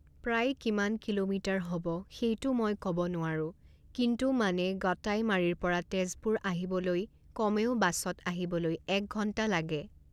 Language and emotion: Assamese, neutral